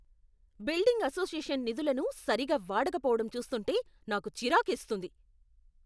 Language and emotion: Telugu, angry